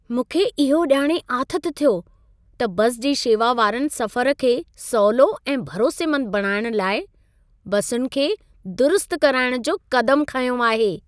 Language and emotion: Sindhi, happy